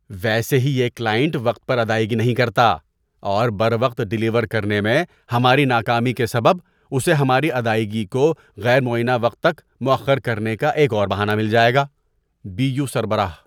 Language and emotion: Urdu, disgusted